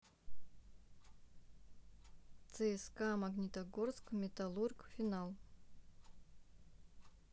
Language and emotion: Russian, neutral